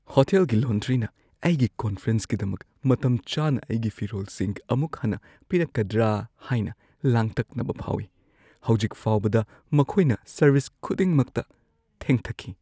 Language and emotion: Manipuri, fearful